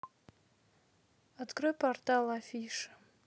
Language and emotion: Russian, neutral